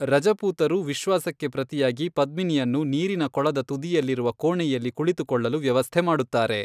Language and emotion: Kannada, neutral